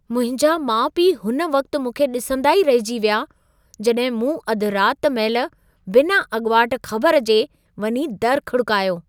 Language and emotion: Sindhi, surprised